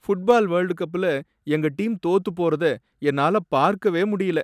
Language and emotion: Tamil, sad